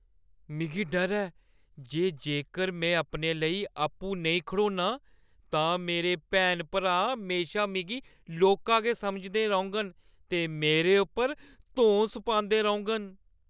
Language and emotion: Dogri, fearful